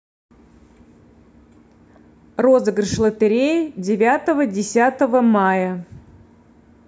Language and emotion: Russian, neutral